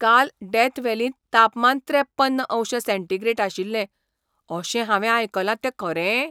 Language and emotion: Goan Konkani, surprised